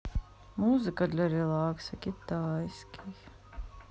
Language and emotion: Russian, sad